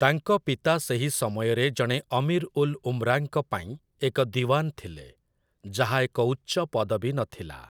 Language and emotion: Odia, neutral